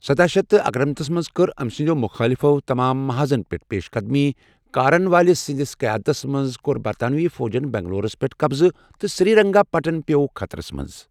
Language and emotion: Kashmiri, neutral